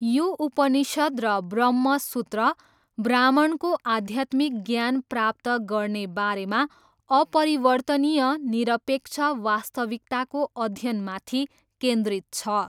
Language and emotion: Nepali, neutral